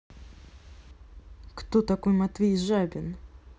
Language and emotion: Russian, neutral